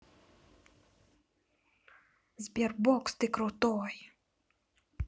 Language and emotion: Russian, positive